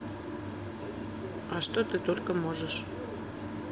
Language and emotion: Russian, neutral